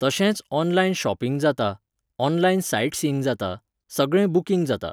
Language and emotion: Goan Konkani, neutral